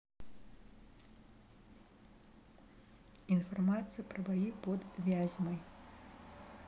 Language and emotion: Russian, neutral